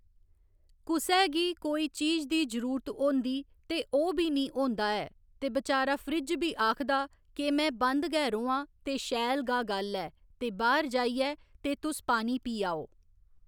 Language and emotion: Dogri, neutral